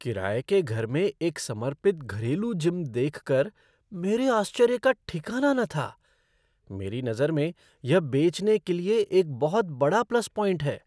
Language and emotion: Hindi, surprised